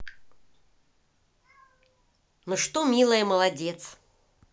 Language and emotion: Russian, positive